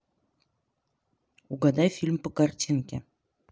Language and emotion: Russian, neutral